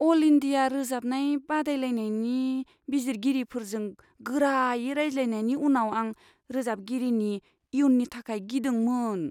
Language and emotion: Bodo, fearful